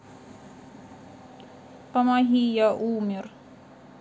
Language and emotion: Russian, sad